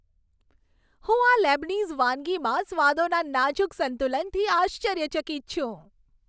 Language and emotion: Gujarati, happy